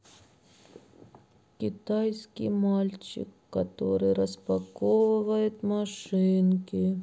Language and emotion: Russian, sad